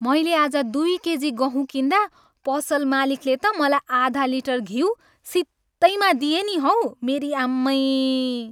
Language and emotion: Nepali, happy